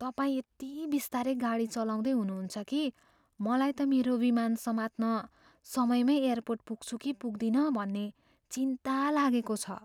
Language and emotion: Nepali, fearful